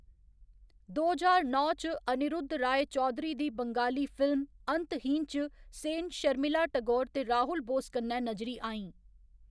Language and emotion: Dogri, neutral